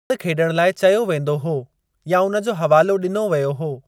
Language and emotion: Sindhi, neutral